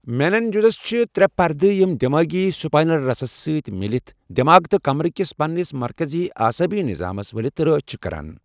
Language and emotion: Kashmiri, neutral